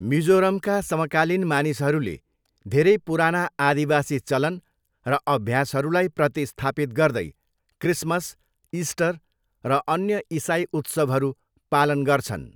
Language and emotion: Nepali, neutral